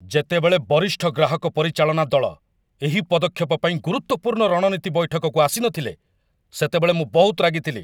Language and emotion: Odia, angry